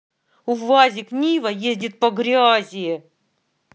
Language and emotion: Russian, angry